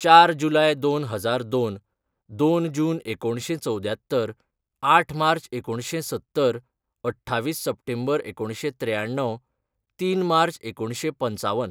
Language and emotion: Goan Konkani, neutral